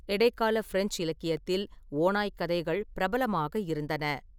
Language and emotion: Tamil, neutral